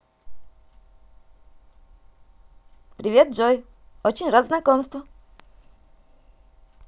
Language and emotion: Russian, positive